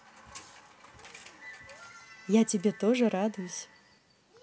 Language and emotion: Russian, positive